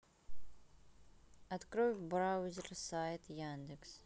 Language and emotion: Russian, sad